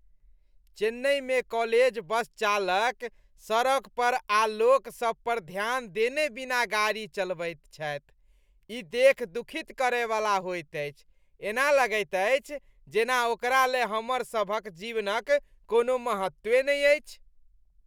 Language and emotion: Maithili, disgusted